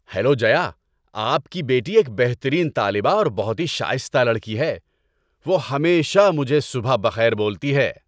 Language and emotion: Urdu, happy